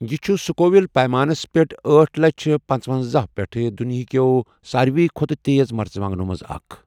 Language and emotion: Kashmiri, neutral